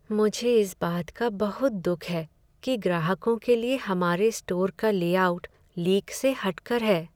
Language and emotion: Hindi, sad